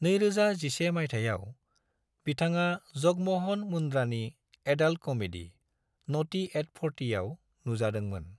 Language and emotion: Bodo, neutral